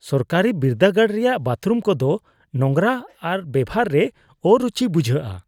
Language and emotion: Santali, disgusted